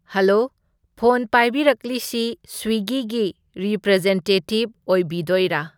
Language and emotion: Manipuri, neutral